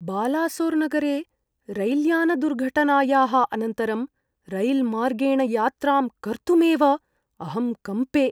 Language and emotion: Sanskrit, fearful